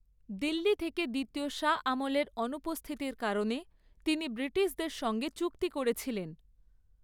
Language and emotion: Bengali, neutral